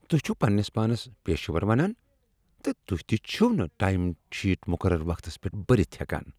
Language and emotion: Kashmiri, disgusted